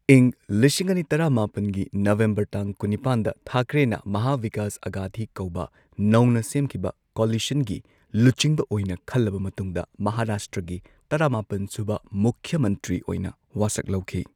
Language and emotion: Manipuri, neutral